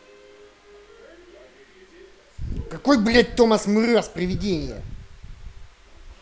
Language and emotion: Russian, angry